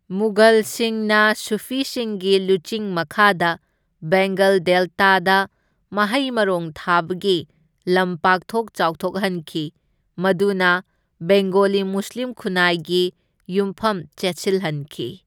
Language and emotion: Manipuri, neutral